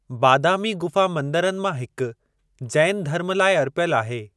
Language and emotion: Sindhi, neutral